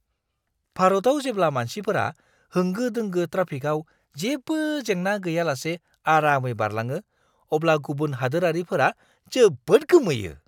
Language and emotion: Bodo, surprised